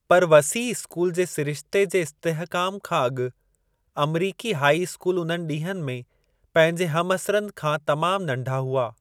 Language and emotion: Sindhi, neutral